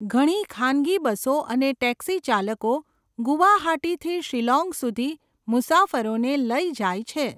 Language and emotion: Gujarati, neutral